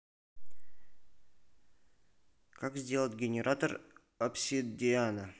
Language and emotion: Russian, neutral